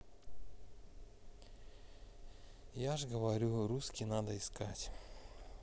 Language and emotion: Russian, sad